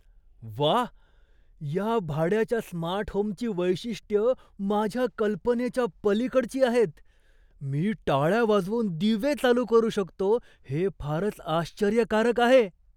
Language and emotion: Marathi, surprised